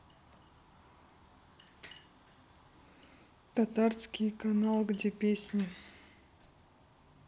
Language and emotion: Russian, neutral